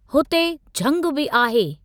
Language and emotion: Sindhi, neutral